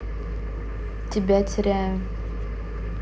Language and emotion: Russian, neutral